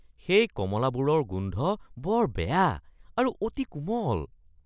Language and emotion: Assamese, disgusted